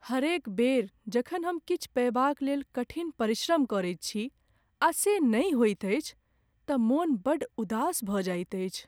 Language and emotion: Maithili, sad